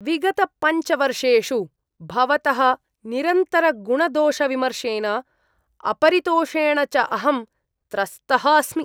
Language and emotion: Sanskrit, disgusted